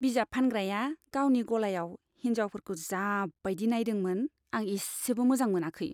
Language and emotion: Bodo, disgusted